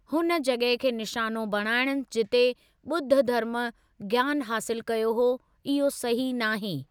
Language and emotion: Sindhi, neutral